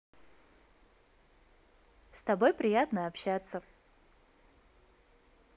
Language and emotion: Russian, positive